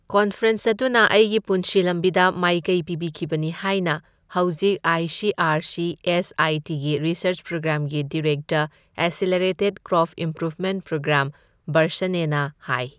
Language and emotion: Manipuri, neutral